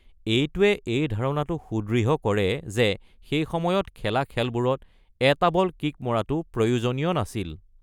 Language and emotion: Assamese, neutral